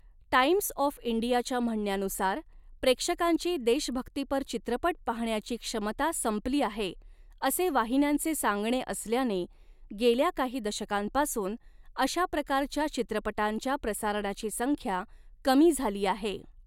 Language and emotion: Marathi, neutral